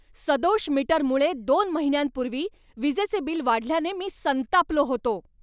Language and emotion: Marathi, angry